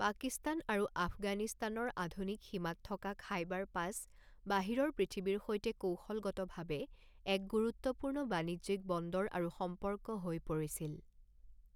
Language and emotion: Assamese, neutral